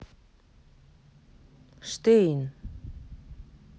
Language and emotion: Russian, neutral